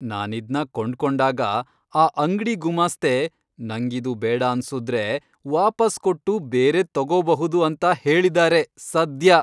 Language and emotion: Kannada, happy